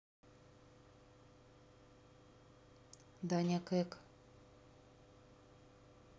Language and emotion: Russian, neutral